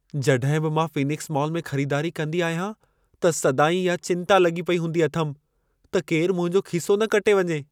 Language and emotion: Sindhi, fearful